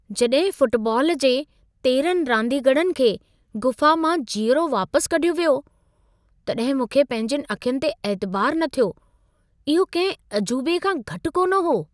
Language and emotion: Sindhi, surprised